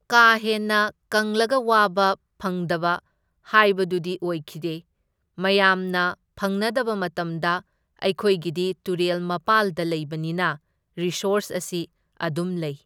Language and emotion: Manipuri, neutral